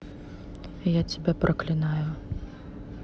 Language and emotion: Russian, neutral